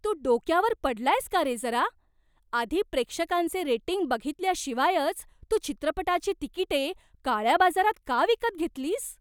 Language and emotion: Marathi, surprised